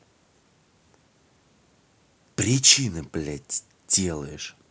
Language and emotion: Russian, angry